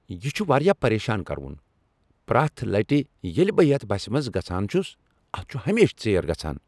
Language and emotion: Kashmiri, angry